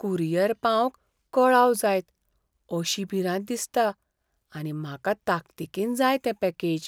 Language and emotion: Goan Konkani, fearful